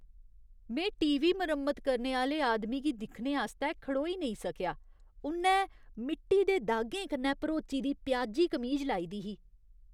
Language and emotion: Dogri, disgusted